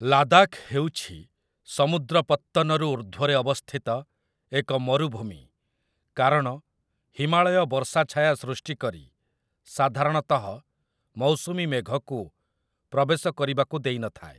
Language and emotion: Odia, neutral